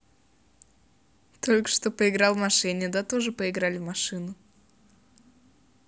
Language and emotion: Russian, positive